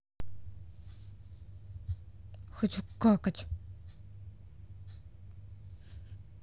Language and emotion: Russian, angry